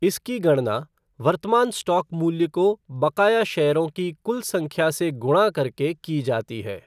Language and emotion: Hindi, neutral